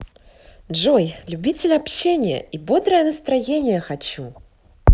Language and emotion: Russian, positive